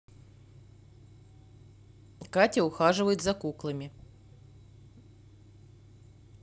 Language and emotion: Russian, neutral